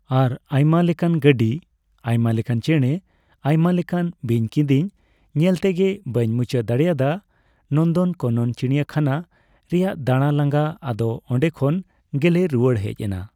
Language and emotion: Santali, neutral